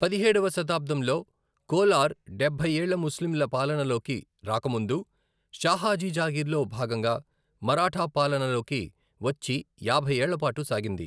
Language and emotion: Telugu, neutral